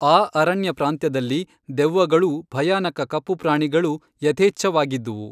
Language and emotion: Kannada, neutral